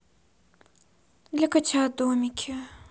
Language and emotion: Russian, sad